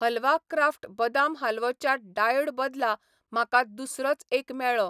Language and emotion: Goan Konkani, neutral